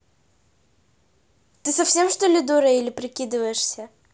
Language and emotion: Russian, angry